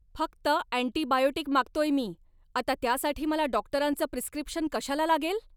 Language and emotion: Marathi, angry